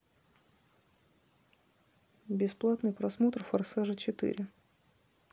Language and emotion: Russian, neutral